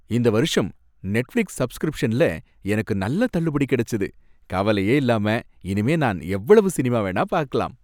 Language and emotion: Tamil, happy